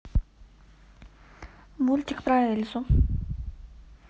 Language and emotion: Russian, neutral